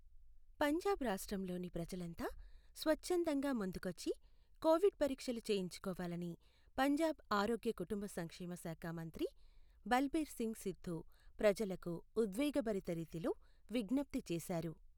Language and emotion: Telugu, neutral